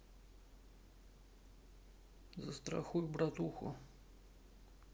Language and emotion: Russian, neutral